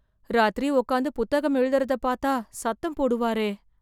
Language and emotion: Tamil, fearful